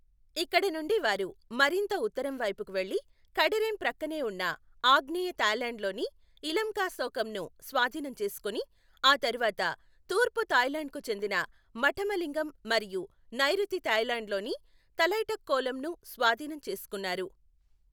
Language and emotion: Telugu, neutral